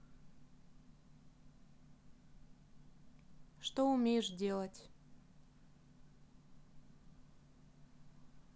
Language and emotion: Russian, neutral